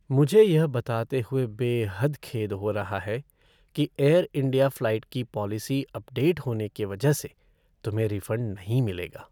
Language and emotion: Hindi, sad